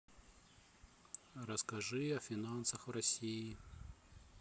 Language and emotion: Russian, neutral